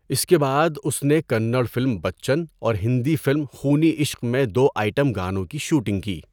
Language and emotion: Urdu, neutral